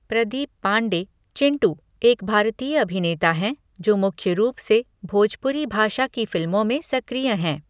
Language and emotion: Hindi, neutral